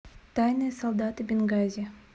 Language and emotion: Russian, neutral